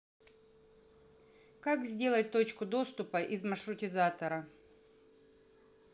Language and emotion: Russian, neutral